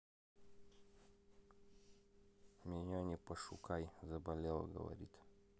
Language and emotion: Russian, neutral